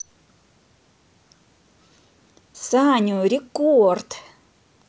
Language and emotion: Russian, positive